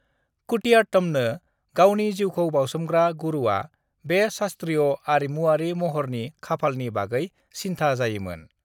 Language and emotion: Bodo, neutral